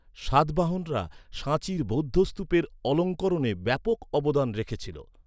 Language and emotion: Bengali, neutral